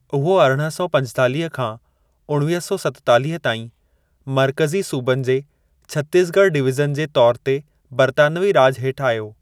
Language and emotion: Sindhi, neutral